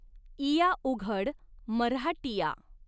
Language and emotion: Marathi, neutral